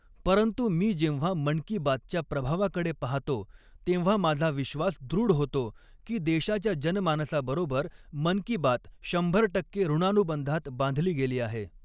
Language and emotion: Marathi, neutral